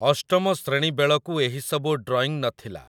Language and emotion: Odia, neutral